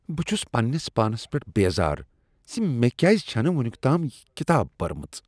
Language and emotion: Kashmiri, disgusted